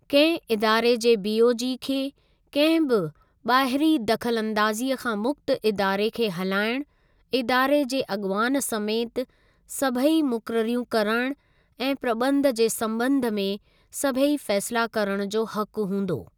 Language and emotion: Sindhi, neutral